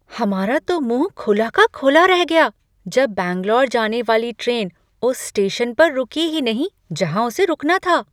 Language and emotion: Hindi, surprised